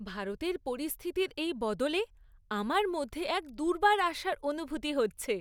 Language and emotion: Bengali, happy